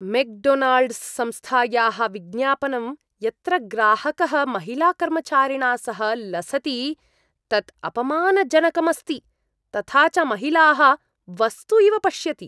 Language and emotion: Sanskrit, disgusted